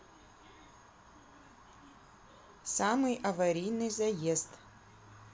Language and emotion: Russian, neutral